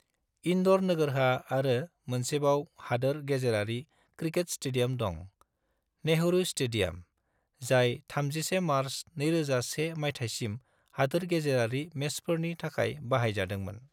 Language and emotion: Bodo, neutral